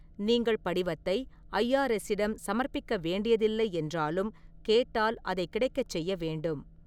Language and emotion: Tamil, neutral